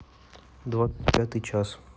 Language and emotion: Russian, neutral